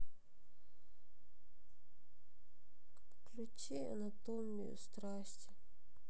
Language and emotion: Russian, sad